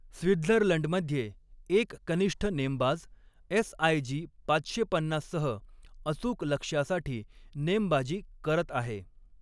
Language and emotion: Marathi, neutral